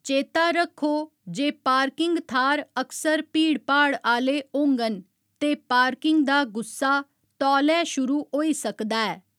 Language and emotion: Dogri, neutral